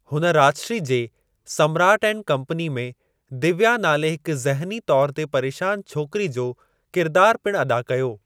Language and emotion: Sindhi, neutral